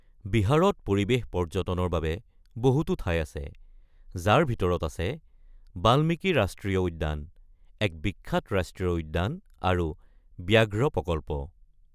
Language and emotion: Assamese, neutral